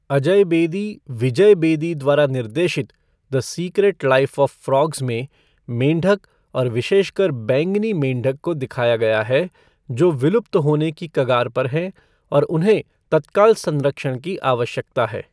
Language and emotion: Hindi, neutral